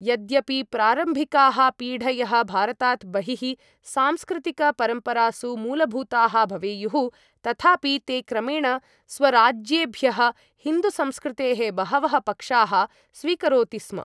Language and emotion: Sanskrit, neutral